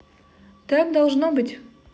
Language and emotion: Russian, positive